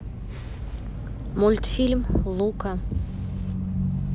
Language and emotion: Russian, neutral